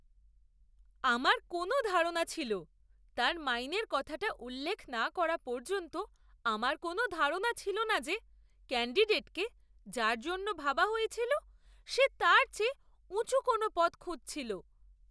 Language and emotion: Bengali, surprised